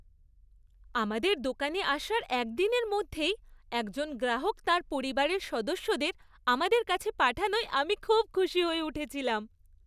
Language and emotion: Bengali, happy